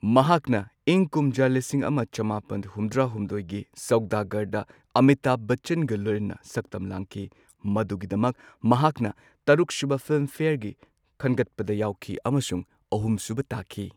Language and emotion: Manipuri, neutral